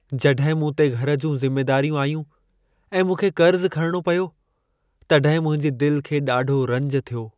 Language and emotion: Sindhi, sad